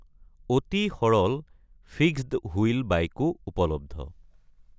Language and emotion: Assamese, neutral